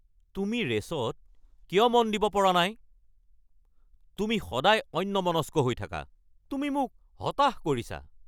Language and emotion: Assamese, angry